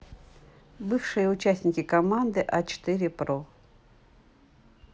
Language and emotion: Russian, neutral